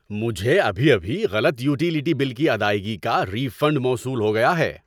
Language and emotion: Urdu, happy